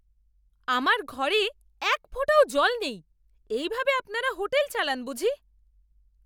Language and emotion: Bengali, angry